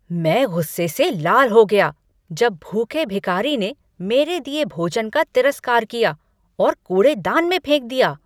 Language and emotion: Hindi, angry